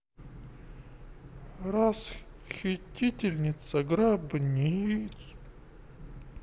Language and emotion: Russian, sad